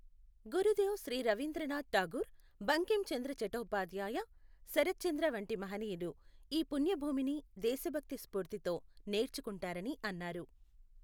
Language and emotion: Telugu, neutral